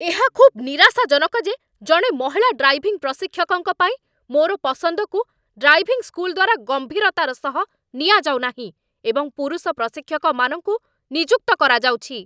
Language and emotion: Odia, angry